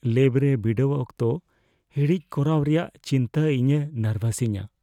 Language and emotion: Santali, fearful